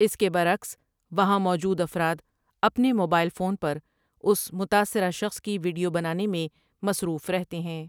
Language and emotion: Urdu, neutral